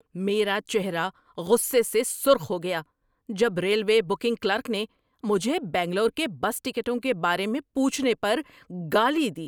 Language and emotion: Urdu, angry